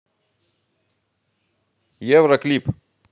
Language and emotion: Russian, positive